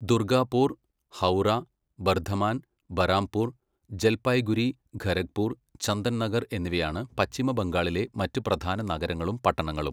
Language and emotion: Malayalam, neutral